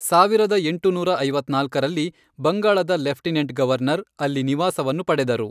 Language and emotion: Kannada, neutral